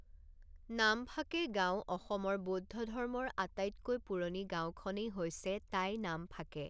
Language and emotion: Assamese, neutral